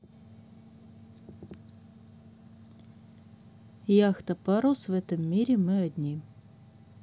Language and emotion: Russian, neutral